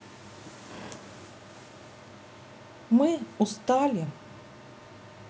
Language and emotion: Russian, neutral